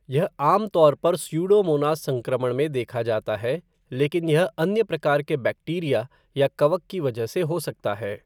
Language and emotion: Hindi, neutral